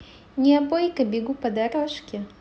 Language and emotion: Russian, positive